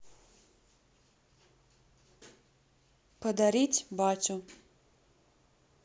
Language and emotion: Russian, neutral